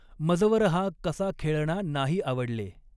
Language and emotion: Marathi, neutral